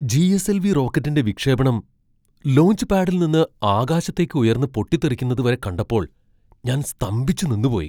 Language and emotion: Malayalam, surprised